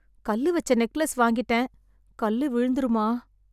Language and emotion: Tamil, sad